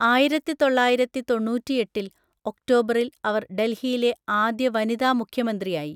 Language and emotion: Malayalam, neutral